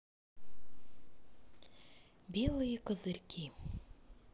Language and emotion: Russian, neutral